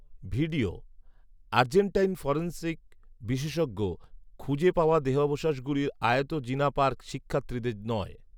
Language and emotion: Bengali, neutral